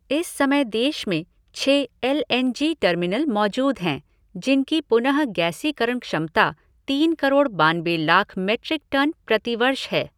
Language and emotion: Hindi, neutral